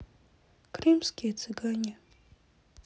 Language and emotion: Russian, sad